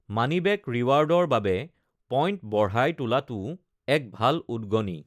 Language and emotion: Assamese, neutral